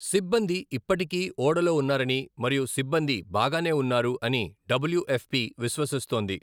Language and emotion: Telugu, neutral